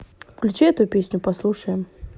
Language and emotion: Russian, neutral